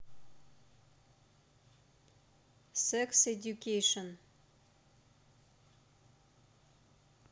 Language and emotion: Russian, neutral